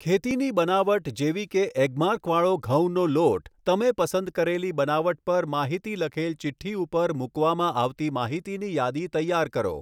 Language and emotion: Gujarati, neutral